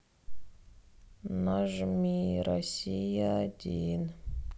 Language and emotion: Russian, sad